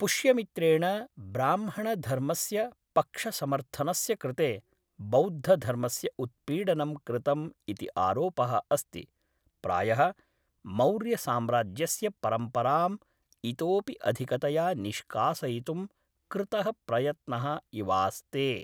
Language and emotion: Sanskrit, neutral